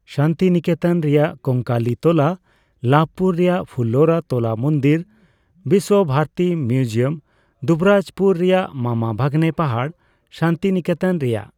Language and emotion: Santali, neutral